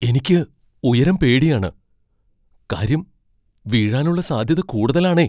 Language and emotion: Malayalam, fearful